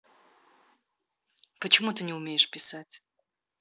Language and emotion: Russian, neutral